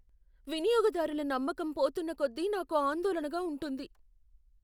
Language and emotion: Telugu, fearful